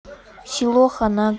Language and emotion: Russian, neutral